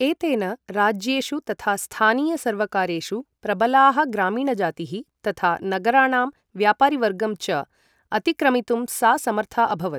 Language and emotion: Sanskrit, neutral